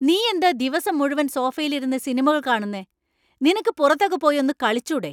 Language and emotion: Malayalam, angry